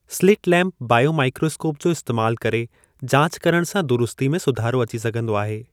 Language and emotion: Sindhi, neutral